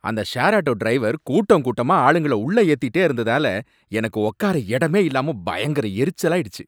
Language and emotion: Tamil, angry